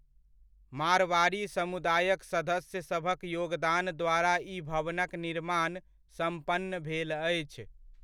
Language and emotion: Maithili, neutral